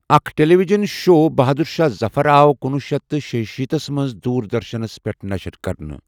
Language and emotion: Kashmiri, neutral